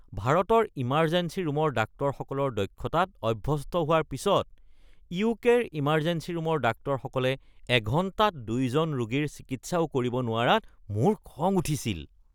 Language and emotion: Assamese, disgusted